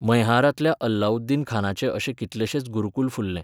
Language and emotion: Goan Konkani, neutral